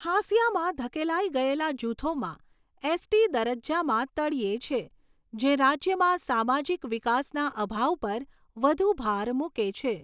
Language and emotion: Gujarati, neutral